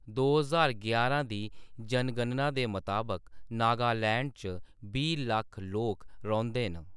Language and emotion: Dogri, neutral